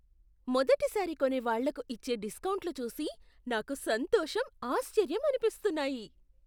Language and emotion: Telugu, surprised